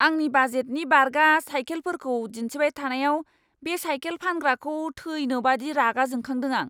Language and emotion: Bodo, angry